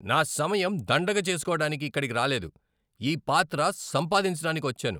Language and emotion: Telugu, angry